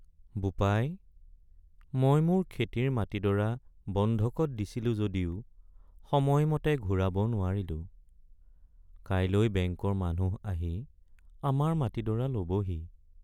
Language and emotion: Assamese, sad